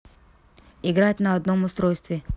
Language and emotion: Russian, neutral